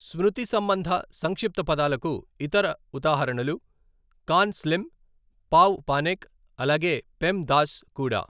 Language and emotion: Telugu, neutral